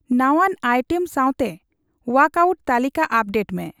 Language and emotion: Santali, neutral